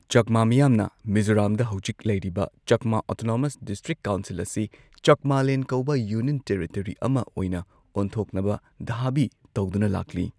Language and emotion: Manipuri, neutral